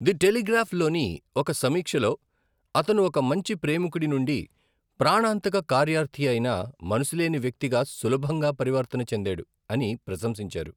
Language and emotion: Telugu, neutral